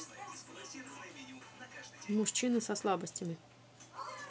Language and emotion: Russian, neutral